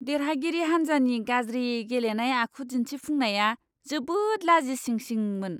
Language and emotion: Bodo, disgusted